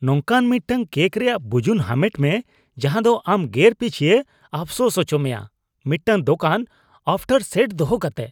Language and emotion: Santali, disgusted